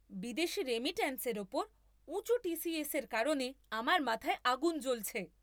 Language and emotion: Bengali, angry